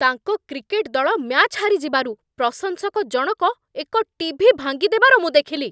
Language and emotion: Odia, angry